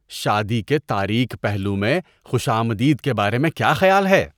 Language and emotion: Urdu, disgusted